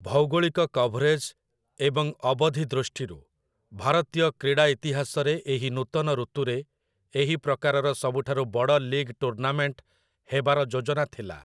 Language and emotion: Odia, neutral